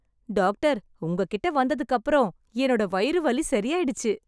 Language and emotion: Tamil, happy